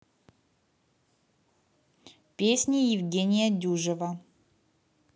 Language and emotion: Russian, neutral